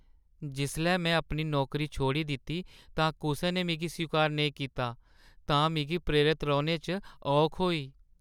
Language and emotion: Dogri, sad